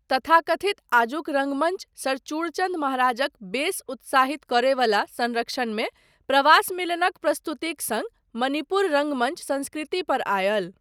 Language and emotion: Maithili, neutral